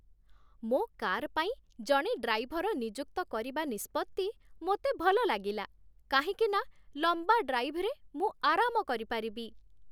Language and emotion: Odia, happy